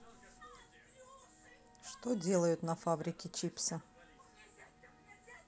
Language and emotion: Russian, neutral